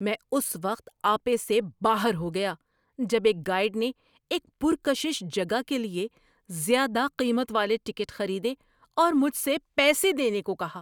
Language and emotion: Urdu, angry